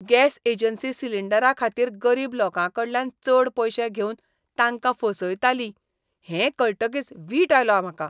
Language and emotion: Goan Konkani, disgusted